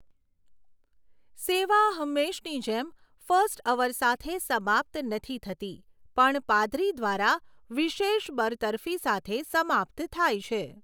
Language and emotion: Gujarati, neutral